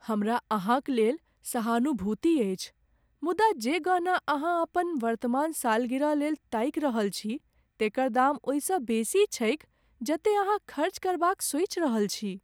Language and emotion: Maithili, sad